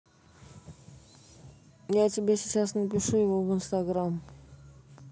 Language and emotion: Russian, neutral